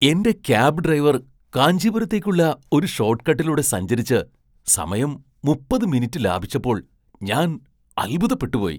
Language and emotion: Malayalam, surprised